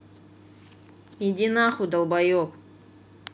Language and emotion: Russian, angry